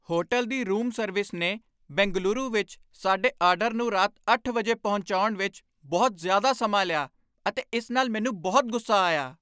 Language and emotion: Punjabi, angry